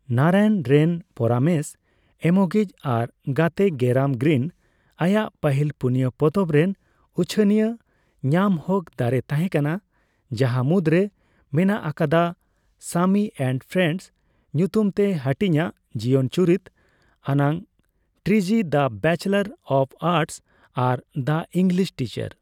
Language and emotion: Santali, neutral